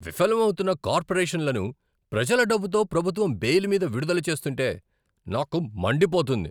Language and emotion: Telugu, angry